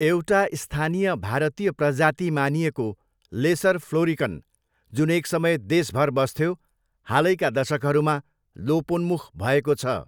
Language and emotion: Nepali, neutral